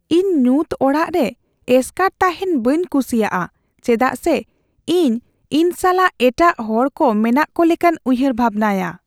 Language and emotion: Santali, fearful